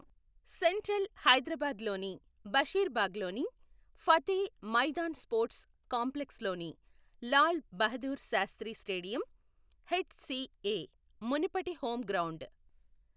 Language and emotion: Telugu, neutral